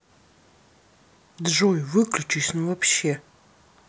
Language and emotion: Russian, angry